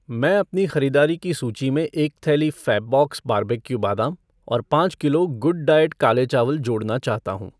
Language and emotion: Hindi, neutral